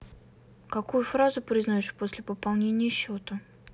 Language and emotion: Russian, neutral